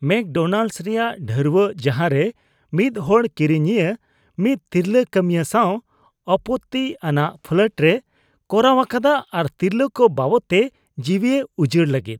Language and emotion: Santali, disgusted